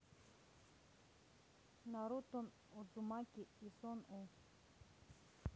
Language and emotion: Russian, neutral